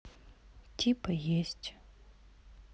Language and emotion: Russian, sad